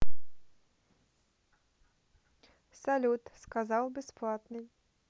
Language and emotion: Russian, neutral